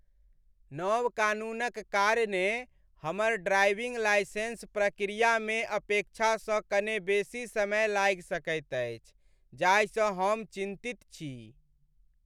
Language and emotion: Maithili, sad